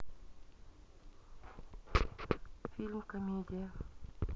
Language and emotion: Russian, neutral